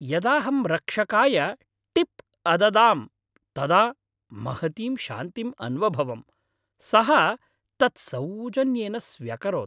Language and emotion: Sanskrit, happy